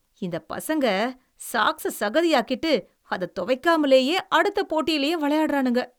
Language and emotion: Tamil, disgusted